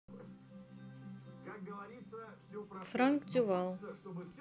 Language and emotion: Russian, neutral